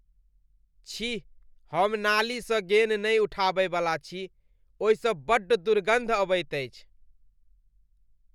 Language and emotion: Maithili, disgusted